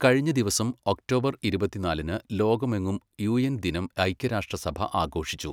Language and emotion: Malayalam, neutral